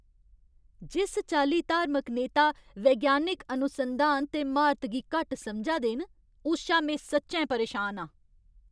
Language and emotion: Dogri, angry